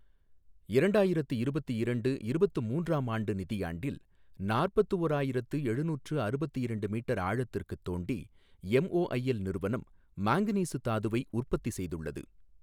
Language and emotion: Tamil, neutral